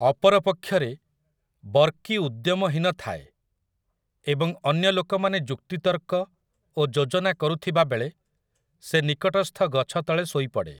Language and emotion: Odia, neutral